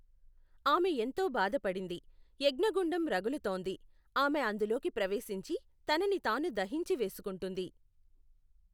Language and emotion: Telugu, neutral